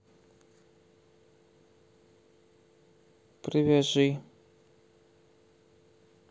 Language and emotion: Russian, neutral